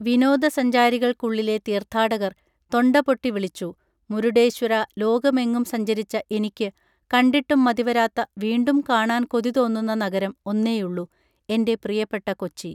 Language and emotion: Malayalam, neutral